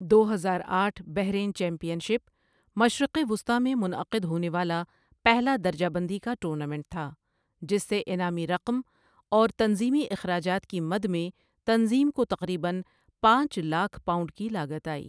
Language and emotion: Urdu, neutral